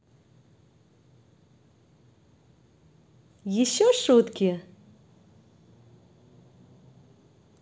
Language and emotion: Russian, positive